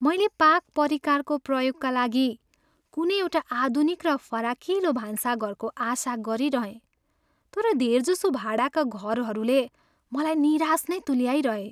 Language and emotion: Nepali, sad